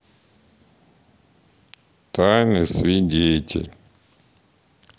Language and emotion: Russian, sad